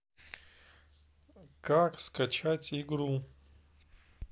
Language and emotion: Russian, neutral